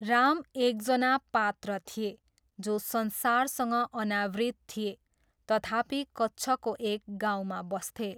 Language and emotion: Nepali, neutral